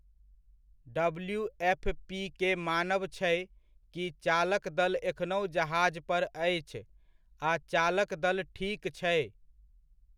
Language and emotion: Maithili, neutral